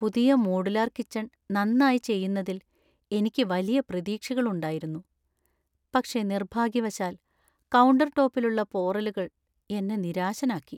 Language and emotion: Malayalam, sad